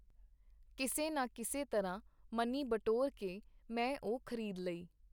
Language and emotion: Punjabi, neutral